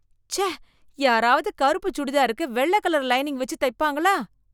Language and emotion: Tamil, disgusted